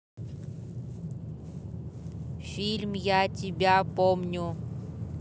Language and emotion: Russian, neutral